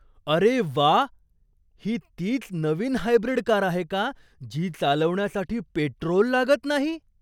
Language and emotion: Marathi, surprised